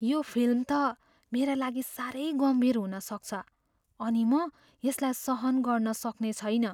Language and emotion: Nepali, fearful